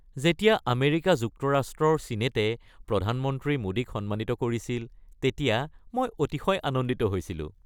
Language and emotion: Assamese, happy